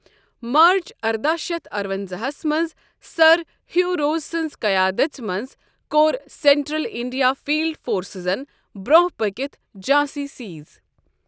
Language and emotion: Kashmiri, neutral